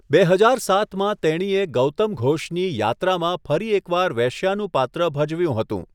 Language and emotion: Gujarati, neutral